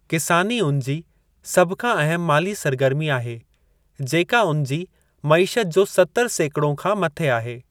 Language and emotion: Sindhi, neutral